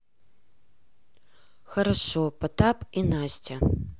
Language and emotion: Russian, neutral